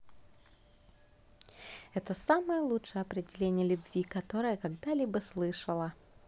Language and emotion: Russian, positive